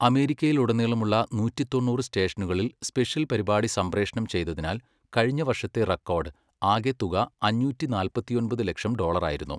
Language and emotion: Malayalam, neutral